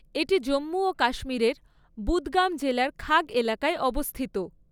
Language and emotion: Bengali, neutral